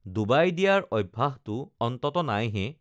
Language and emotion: Assamese, neutral